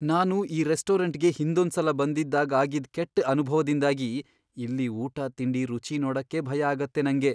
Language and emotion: Kannada, fearful